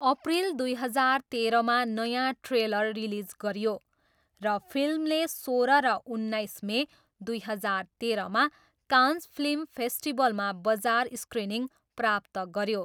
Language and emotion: Nepali, neutral